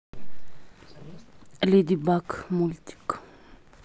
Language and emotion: Russian, neutral